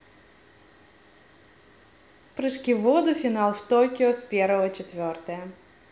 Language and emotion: Russian, positive